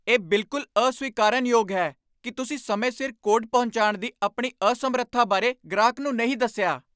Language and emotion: Punjabi, angry